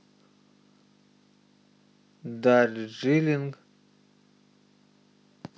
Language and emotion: Russian, neutral